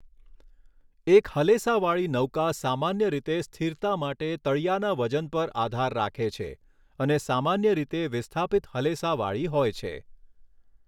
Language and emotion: Gujarati, neutral